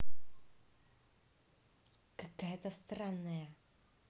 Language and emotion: Russian, angry